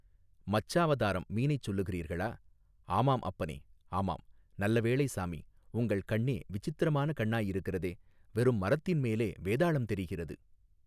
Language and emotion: Tamil, neutral